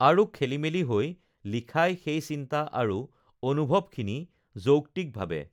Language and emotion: Assamese, neutral